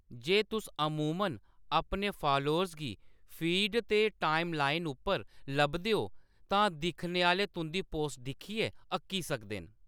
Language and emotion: Dogri, neutral